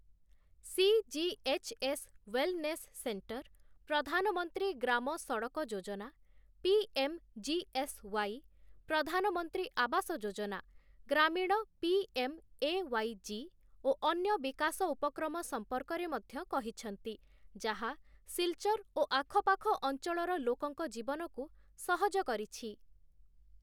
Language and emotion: Odia, neutral